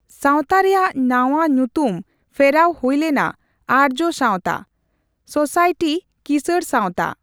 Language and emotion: Santali, neutral